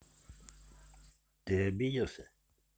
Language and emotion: Russian, neutral